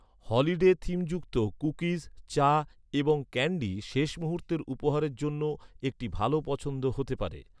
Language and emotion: Bengali, neutral